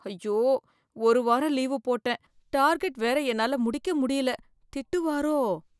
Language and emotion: Tamil, fearful